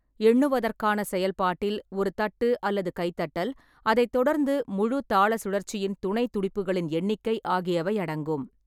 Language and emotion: Tamil, neutral